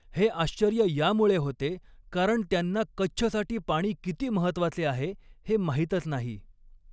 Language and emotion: Marathi, neutral